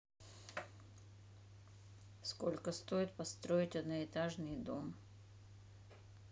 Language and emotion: Russian, neutral